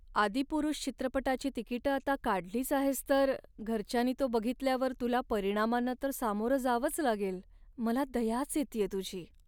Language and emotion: Marathi, sad